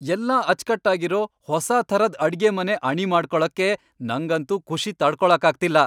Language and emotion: Kannada, happy